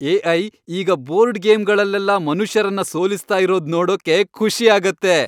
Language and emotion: Kannada, happy